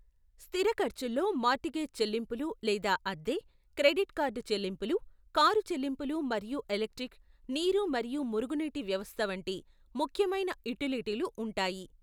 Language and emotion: Telugu, neutral